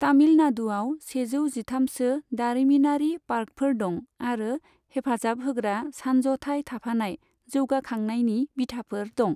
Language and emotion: Bodo, neutral